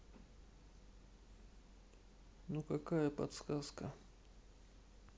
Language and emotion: Russian, sad